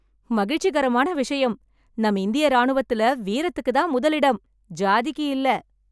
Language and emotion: Tamil, happy